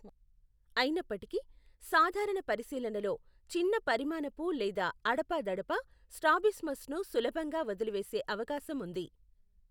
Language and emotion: Telugu, neutral